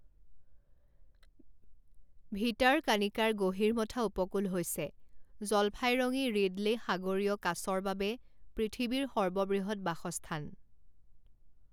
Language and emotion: Assamese, neutral